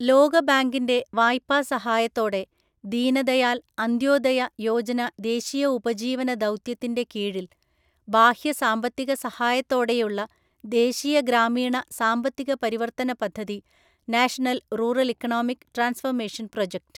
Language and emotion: Malayalam, neutral